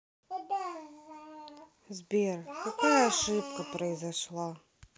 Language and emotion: Russian, sad